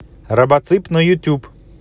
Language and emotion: Russian, neutral